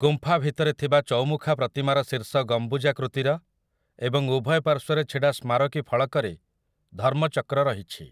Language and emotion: Odia, neutral